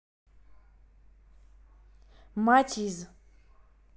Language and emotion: Russian, neutral